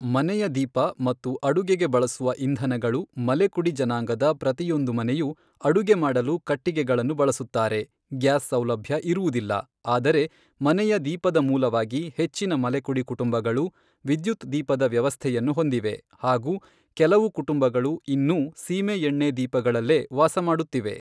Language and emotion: Kannada, neutral